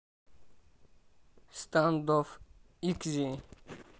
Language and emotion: Russian, neutral